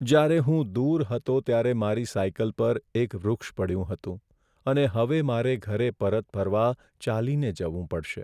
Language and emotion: Gujarati, sad